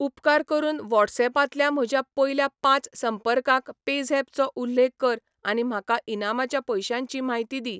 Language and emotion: Goan Konkani, neutral